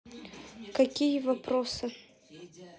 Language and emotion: Russian, neutral